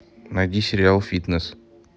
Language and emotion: Russian, neutral